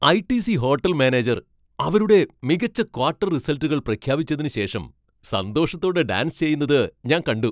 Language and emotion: Malayalam, happy